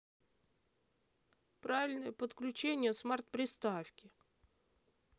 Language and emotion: Russian, neutral